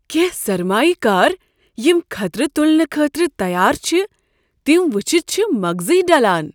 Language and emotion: Kashmiri, surprised